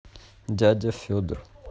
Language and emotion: Russian, neutral